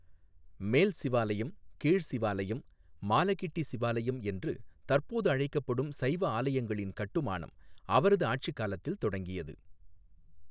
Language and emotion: Tamil, neutral